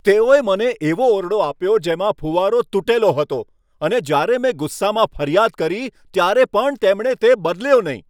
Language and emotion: Gujarati, angry